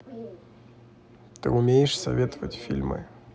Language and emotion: Russian, neutral